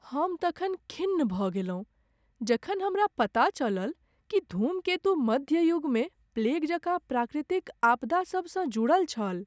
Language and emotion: Maithili, sad